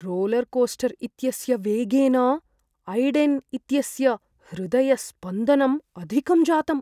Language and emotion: Sanskrit, fearful